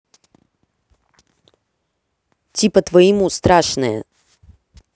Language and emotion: Russian, angry